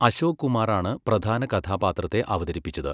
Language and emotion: Malayalam, neutral